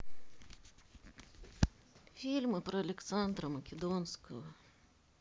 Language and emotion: Russian, sad